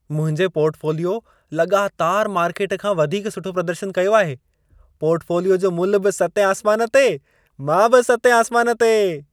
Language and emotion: Sindhi, happy